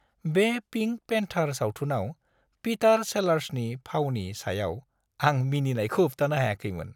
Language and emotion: Bodo, happy